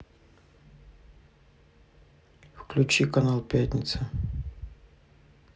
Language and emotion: Russian, neutral